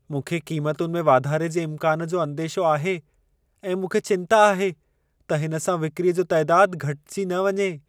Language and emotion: Sindhi, fearful